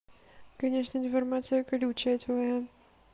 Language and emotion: Russian, neutral